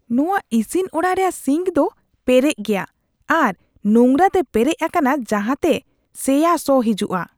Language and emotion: Santali, disgusted